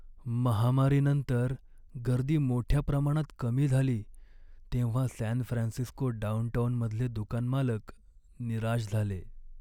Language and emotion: Marathi, sad